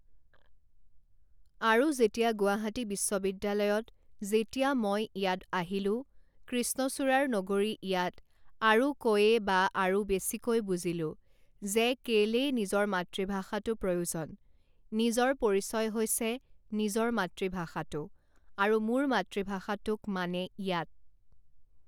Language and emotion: Assamese, neutral